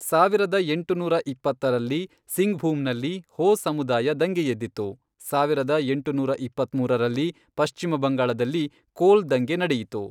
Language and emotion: Kannada, neutral